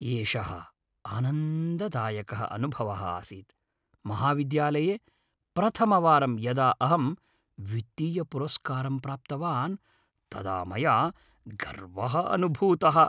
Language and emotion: Sanskrit, happy